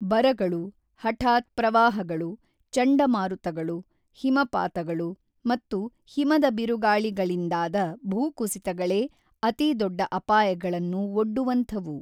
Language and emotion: Kannada, neutral